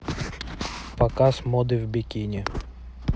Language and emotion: Russian, neutral